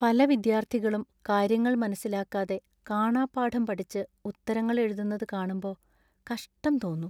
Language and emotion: Malayalam, sad